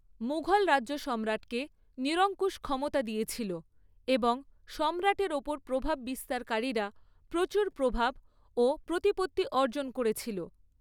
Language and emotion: Bengali, neutral